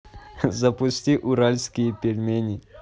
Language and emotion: Russian, positive